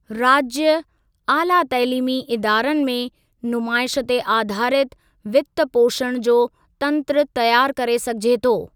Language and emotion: Sindhi, neutral